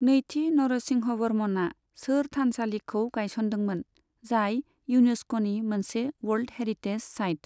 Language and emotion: Bodo, neutral